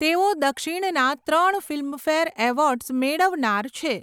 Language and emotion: Gujarati, neutral